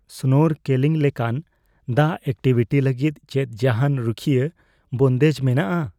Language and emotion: Santali, fearful